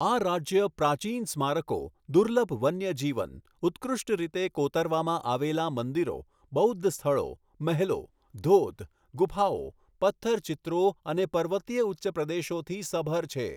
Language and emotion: Gujarati, neutral